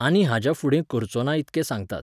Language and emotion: Goan Konkani, neutral